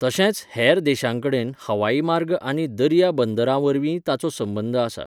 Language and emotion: Goan Konkani, neutral